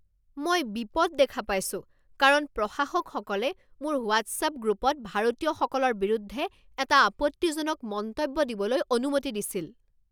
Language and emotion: Assamese, angry